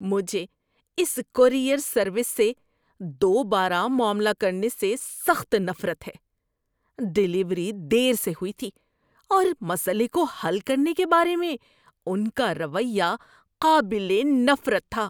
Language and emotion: Urdu, disgusted